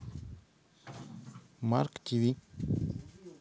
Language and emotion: Russian, neutral